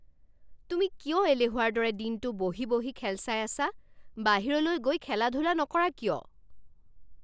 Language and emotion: Assamese, angry